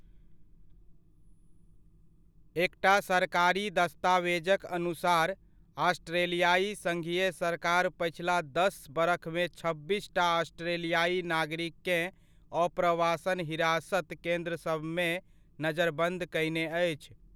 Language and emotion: Maithili, neutral